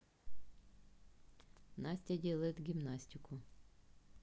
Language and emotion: Russian, neutral